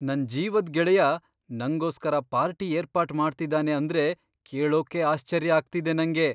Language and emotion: Kannada, surprised